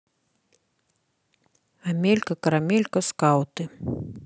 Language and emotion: Russian, neutral